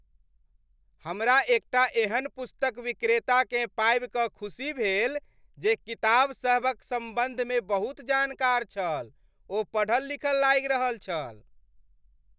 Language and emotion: Maithili, happy